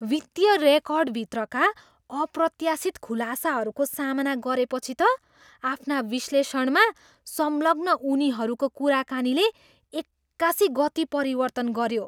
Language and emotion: Nepali, surprised